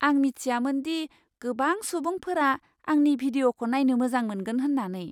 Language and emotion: Bodo, surprised